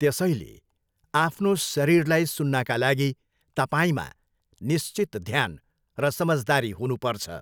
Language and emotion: Nepali, neutral